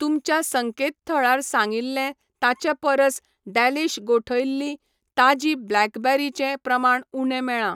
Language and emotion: Goan Konkani, neutral